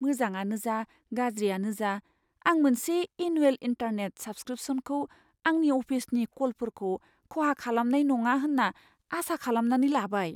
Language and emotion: Bodo, fearful